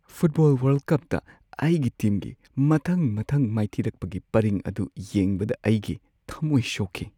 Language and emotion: Manipuri, sad